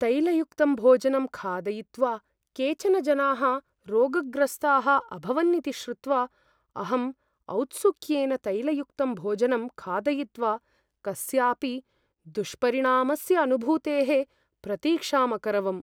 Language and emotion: Sanskrit, fearful